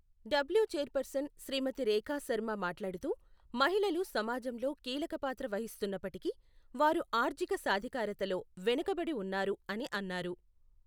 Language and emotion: Telugu, neutral